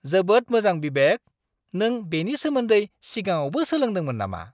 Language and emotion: Bodo, surprised